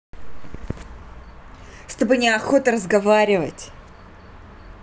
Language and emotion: Russian, angry